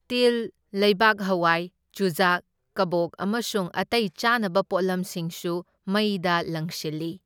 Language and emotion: Manipuri, neutral